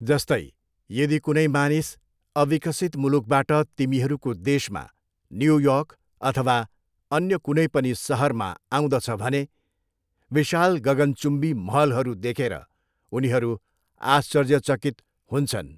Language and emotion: Nepali, neutral